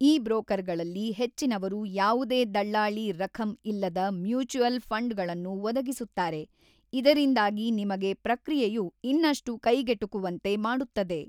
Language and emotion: Kannada, neutral